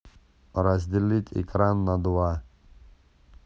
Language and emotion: Russian, neutral